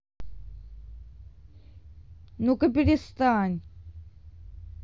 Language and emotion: Russian, angry